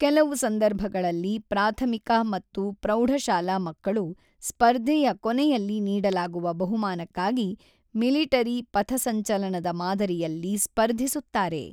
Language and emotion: Kannada, neutral